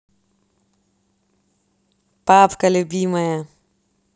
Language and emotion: Russian, positive